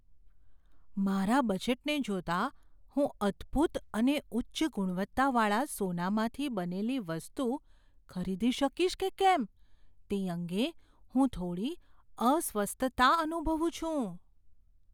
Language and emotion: Gujarati, fearful